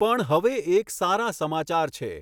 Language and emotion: Gujarati, neutral